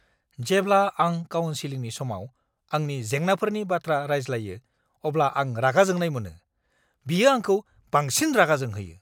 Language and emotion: Bodo, angry